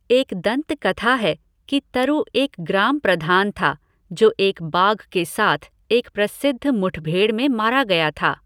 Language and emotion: Hindi, neutral